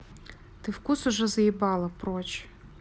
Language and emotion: Russian, neutral